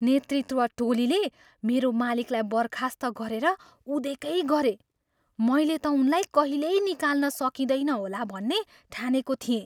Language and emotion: Nepali, surprised